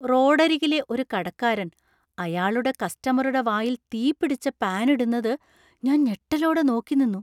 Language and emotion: Malayalam, surprised